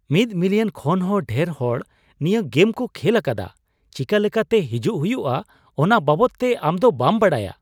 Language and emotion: Santali, surprised